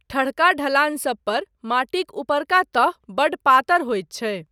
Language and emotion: Maithili, neutral